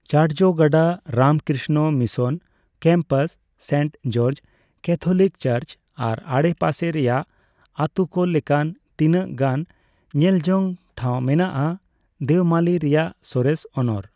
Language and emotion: Santali, neutral